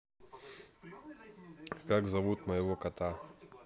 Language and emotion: Russian, neutral